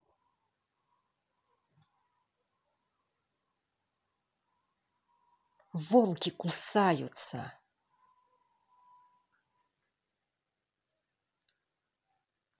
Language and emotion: Russian, angry